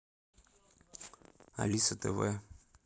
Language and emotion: Russian, neutral